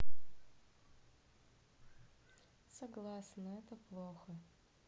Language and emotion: Russian, sad